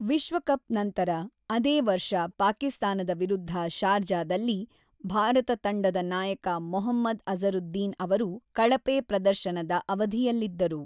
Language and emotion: Kannada, neutral